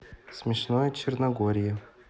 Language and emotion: Russian, neutral